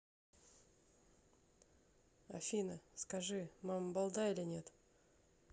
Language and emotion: Russian, neutral